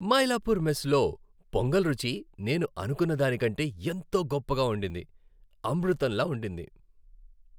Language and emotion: Telugu, happy